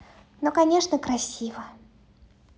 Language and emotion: Russian, positive